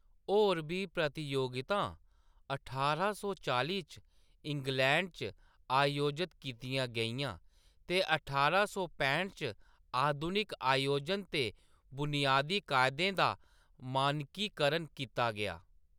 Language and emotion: Dogri, neutral